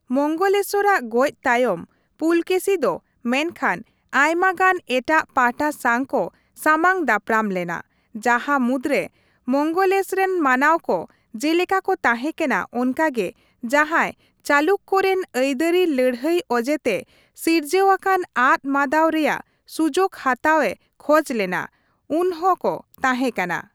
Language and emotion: Santali, neutral